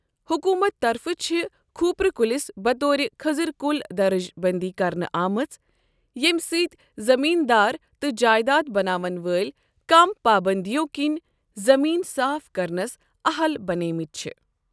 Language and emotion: Kashmiri, neutral